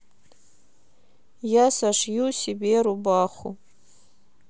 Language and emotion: Russian, neutral